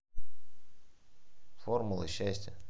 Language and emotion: Russian, neutral